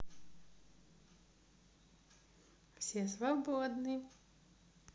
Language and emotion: Russian, positive